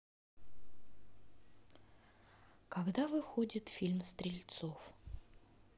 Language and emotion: Russian, neutral